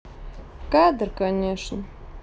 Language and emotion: Russian, sad